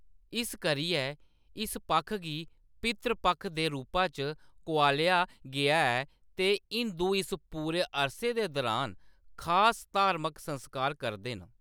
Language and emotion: Dogri, neutral